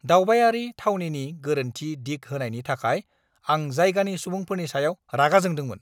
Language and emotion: Bodo, angry